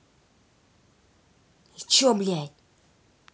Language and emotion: Russian, angry